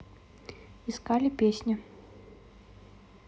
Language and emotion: Russian, neutral